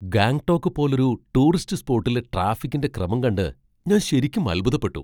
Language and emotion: Malayalam, surprised